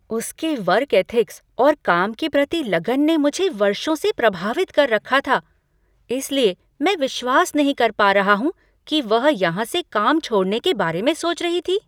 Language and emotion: Hindi, surprised